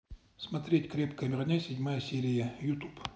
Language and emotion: Russian, neutral